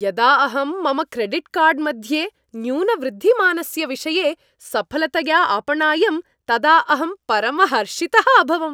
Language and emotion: Sanskrit, happy